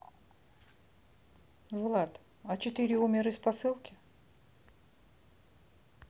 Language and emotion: Russian, neutral